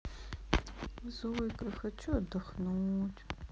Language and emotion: Russian, sad